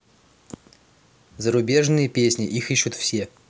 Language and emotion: Russian, neutral